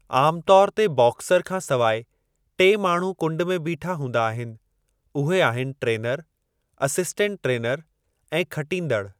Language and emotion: Sindhi, neutral